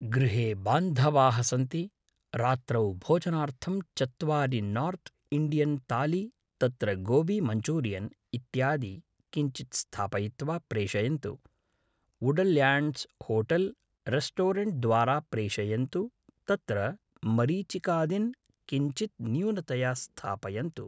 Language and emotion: Sanskrit, neutral